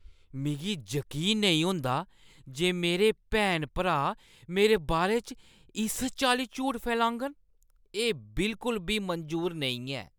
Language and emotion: Dogri, disgusted